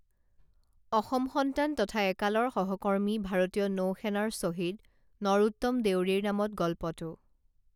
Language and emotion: Assamese, neutral